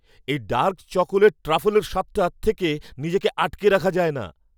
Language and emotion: Bengali, happy